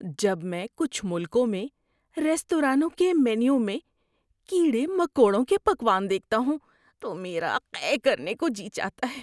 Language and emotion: Urdu, disgusted